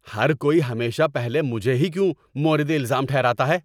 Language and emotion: Urdu, angry